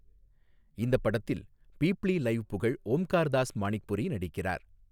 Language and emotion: Tamil, neutral